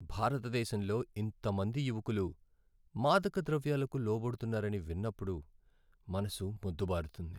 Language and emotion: Telugu, sad